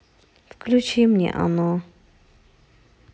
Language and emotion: Russian, sad